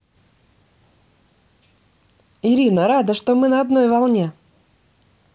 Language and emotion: Russian, positive